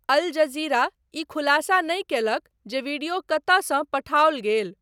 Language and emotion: Maithili, neutral